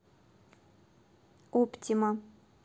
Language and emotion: Russian, neutral